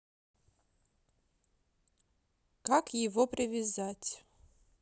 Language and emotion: Russian, neutral